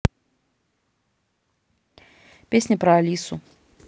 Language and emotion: Russian, neutral